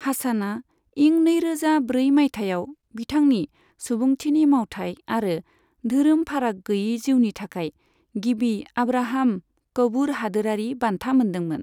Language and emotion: Bodo, neutral